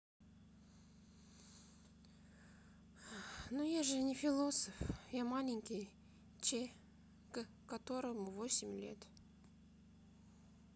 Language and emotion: Russian, sad